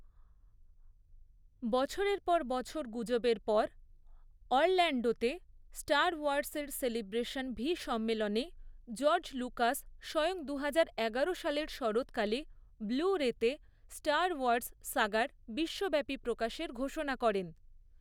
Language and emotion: Bengali, neutral